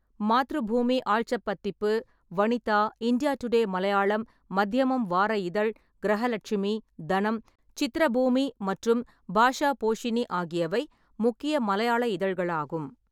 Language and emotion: Tamil, neutral